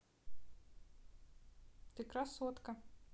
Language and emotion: Russian, neutral